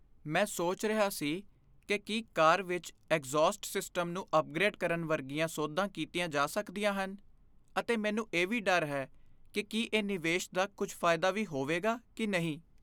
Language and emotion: Punjabi, fearful